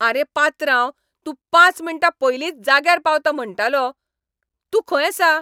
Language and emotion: Goan Konkani, angry